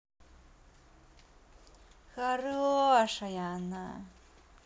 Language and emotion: Russian, positive